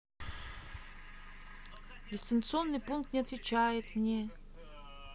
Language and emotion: Russian, sad